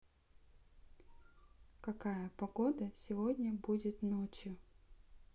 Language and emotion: Russian, neutral